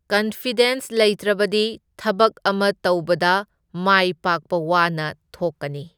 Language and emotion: Manipuri, neutral